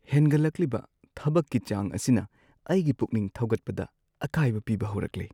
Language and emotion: Manipuri, sad